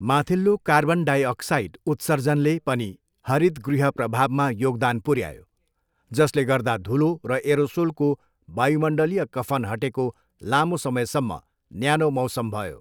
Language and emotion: Nepali, neutral